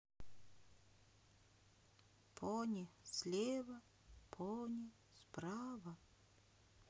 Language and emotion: Russian, sad